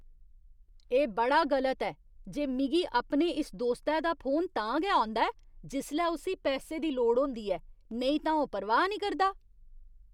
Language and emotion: Dogri, disgusted